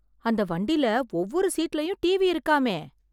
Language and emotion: Tamil, surprised